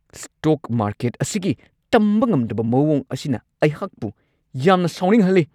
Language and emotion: Manipuri, angry